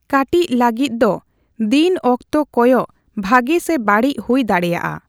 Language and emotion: Santali, neutral